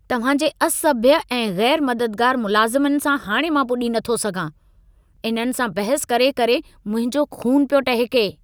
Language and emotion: Sindhi, angry